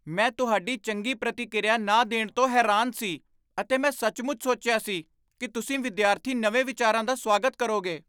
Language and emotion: Punjabi, surprised